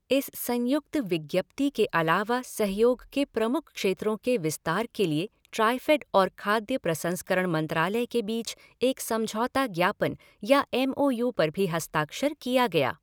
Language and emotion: Hindi, neutral